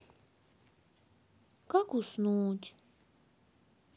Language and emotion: Russian, sad